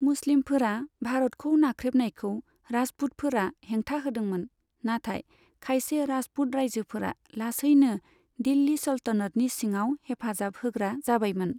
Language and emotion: Bodo, neutral